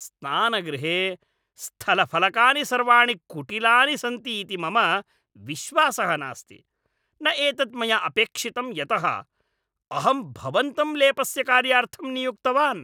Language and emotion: Sanskrit, angry